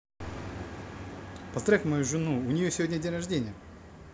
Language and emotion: Russian, positive